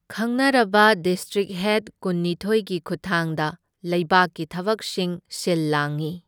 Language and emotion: Manipuri, neutral